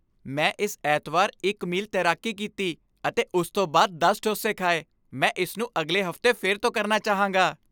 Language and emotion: Punjabi, happy